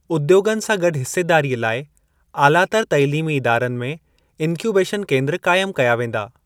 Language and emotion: Sindhi, neutral